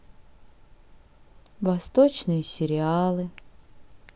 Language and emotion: Russian, sad